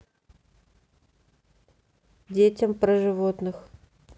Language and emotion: Russian, neutral